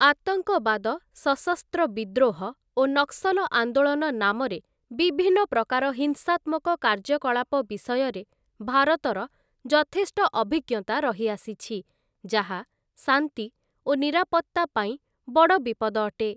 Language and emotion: Odia, neutral